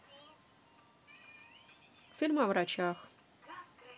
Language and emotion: Russian, neutral